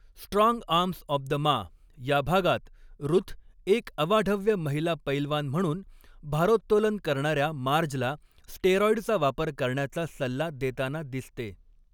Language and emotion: Marathi, neutral